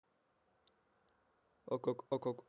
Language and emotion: Russian, neutral